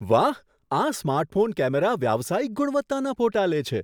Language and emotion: Gujarati, surprised